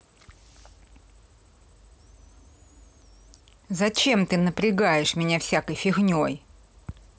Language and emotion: Russian, angry